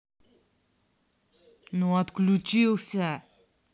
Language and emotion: Russian, angry